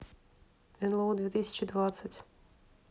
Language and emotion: Russian, neutral